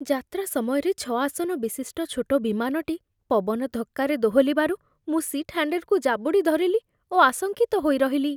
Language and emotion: Odia, fearful